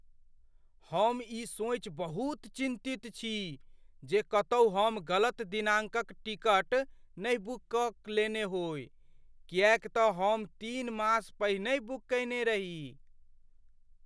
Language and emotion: Maithili, fearful